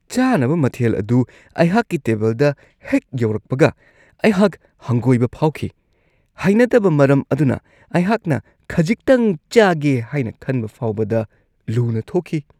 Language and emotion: Manipuri, disgusted